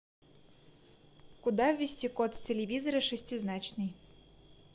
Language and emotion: Russian, neutral